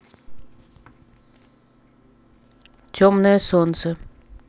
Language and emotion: Russian, neutral